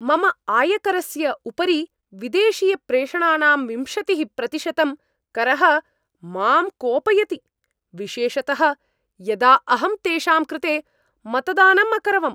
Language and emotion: Sanskrit, angry